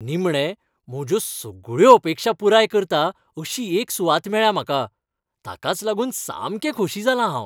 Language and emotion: Goan Konkani, happy